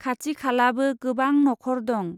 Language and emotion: Bodo, neutral